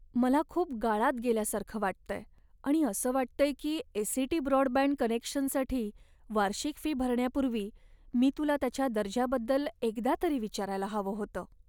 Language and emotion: Marathi, sad